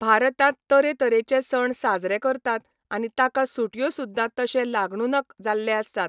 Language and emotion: Goan Konkani, neutral